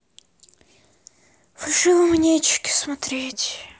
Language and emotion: Russian, sad